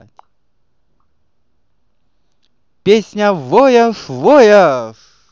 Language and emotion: Russian, positive